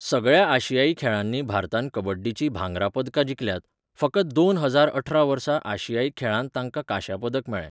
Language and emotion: Goan Konkani, neutral